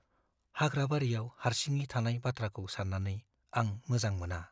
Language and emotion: Bodo, fearful